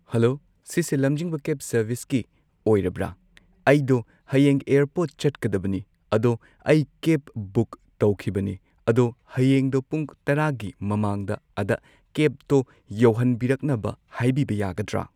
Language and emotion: Manipuri, neutral